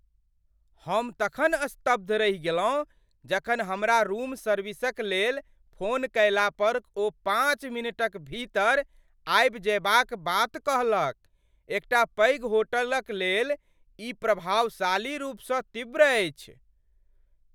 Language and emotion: Maithili, surprised